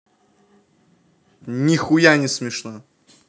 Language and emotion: Russian, angry